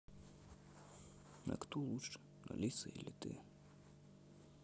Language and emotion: Russian, sad